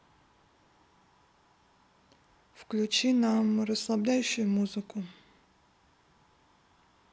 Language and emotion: Russian, neutral